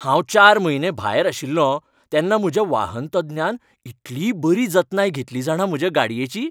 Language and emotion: Goan Konkani, happy